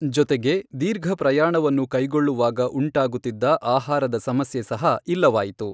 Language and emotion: Kannada, neutral